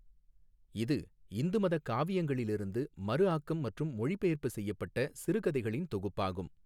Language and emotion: Tamil, neutral